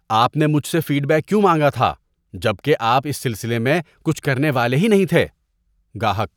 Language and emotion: Urdu, disgusted